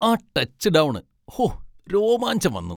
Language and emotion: Malayalam, happy